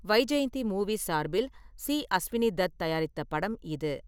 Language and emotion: Tamil, neutral